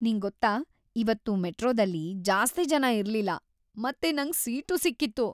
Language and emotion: Kannada, happy